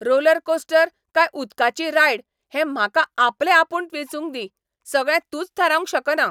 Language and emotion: Goan Konkani, angry